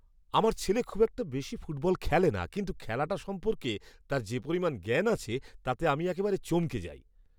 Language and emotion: Bengali, surprised